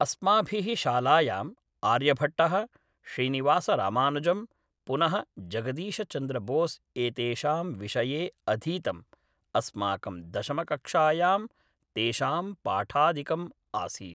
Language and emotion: Sanskrit, neutral